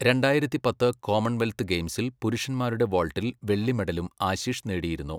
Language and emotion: Malayalam, neutral